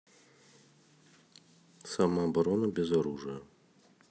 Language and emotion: Russian, neutral